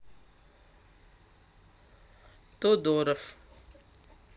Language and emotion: Russian, neutral